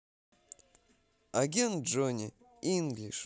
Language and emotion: Russian, positive